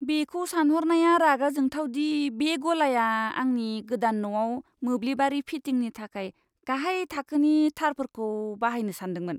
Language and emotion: Bodo, disgusted